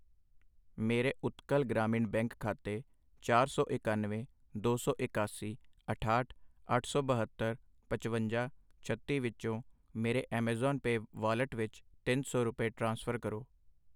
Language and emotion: Punjabi, neutral